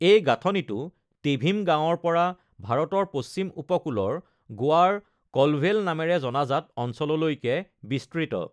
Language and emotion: Assamese, neutral